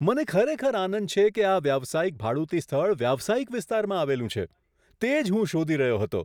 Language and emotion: Gujarati, surprised